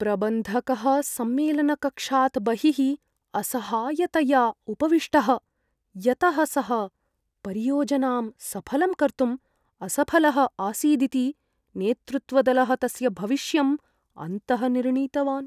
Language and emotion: Sanskrit, fearful